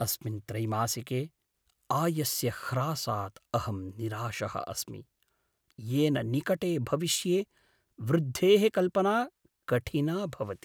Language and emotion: Sanskrit, sad